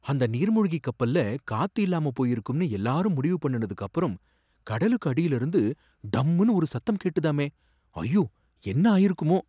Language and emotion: Tamil, surprised